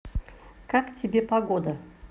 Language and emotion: Russian, positive